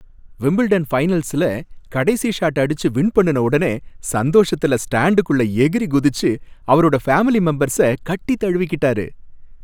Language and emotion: Tamil, happy